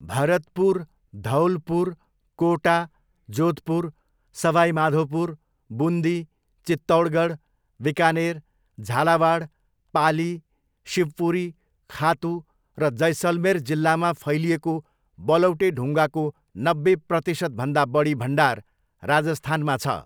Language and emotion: Nepali, neutral